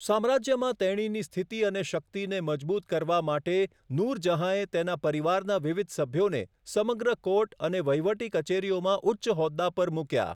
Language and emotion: Gujarati, neutral